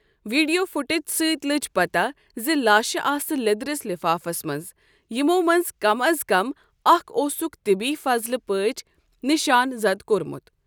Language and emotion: Kashmiri, neutral